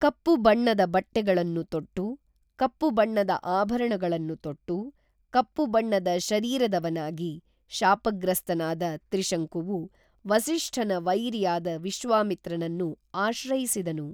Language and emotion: Kannada, neutral